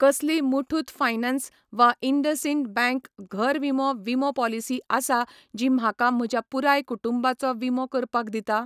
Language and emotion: Goan Konkani, neutral